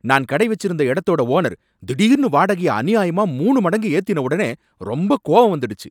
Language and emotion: Tamil, angry